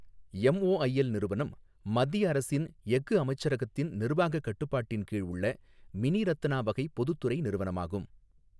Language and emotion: Tamil, neutral